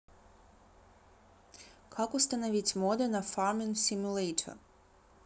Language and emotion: Russian, neutral